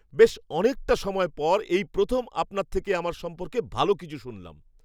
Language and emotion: Bengali, surprised